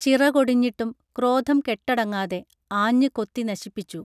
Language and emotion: Malayalam, neutral